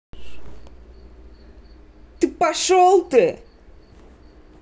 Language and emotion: Russian, angry